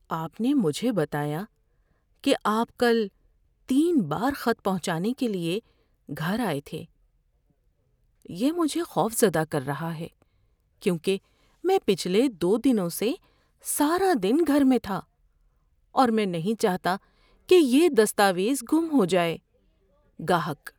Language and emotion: Urdu, fearful